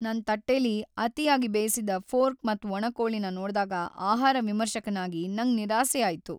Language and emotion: Kannada, sad